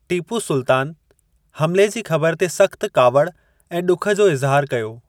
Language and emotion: Sindhi, neutral